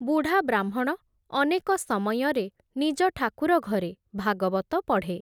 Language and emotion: Odia, neutral